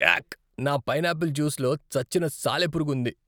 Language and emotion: Telugu, disgusted